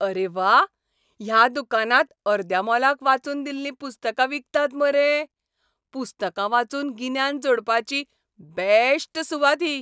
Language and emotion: Goan Konkani, happy